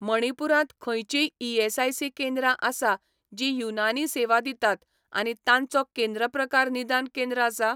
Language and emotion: Goan Konkani, neutral